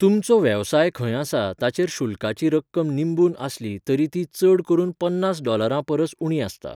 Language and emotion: Goan Konkani, neutral